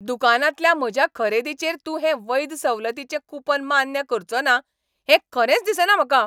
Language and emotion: Goan Konkani, angry